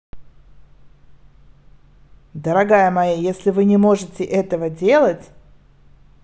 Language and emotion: Russian, neutral